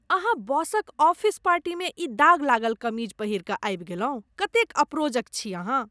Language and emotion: Maithili, disgusted